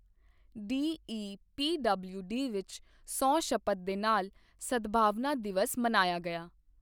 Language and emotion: Punjabi, neutral